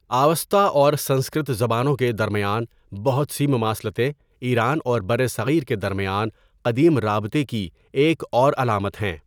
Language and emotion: Urdu, neutral